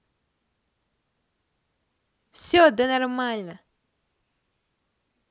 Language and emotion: Russian, positive